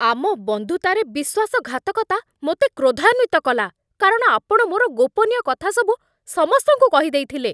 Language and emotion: Odia, angry